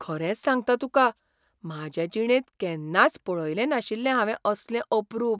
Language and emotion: Goan Konkani, surprised